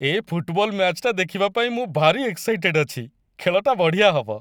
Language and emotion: Odia, happy